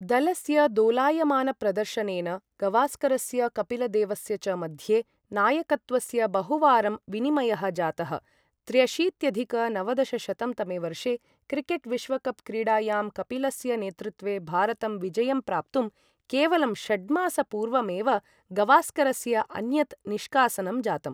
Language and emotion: Sanskrit, neutral